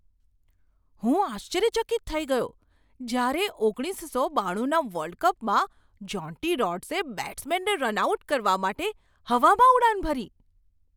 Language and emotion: Gujarati, surprised